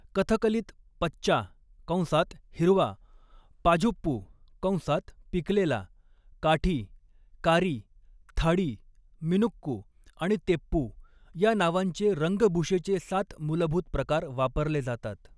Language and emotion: Marathi, neutral